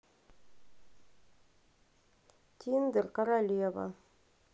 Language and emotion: Russian, neutral